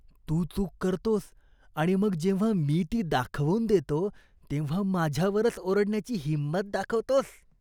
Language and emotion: Marathi, disgusted